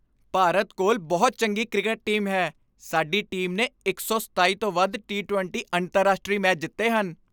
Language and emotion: Punjabi, happy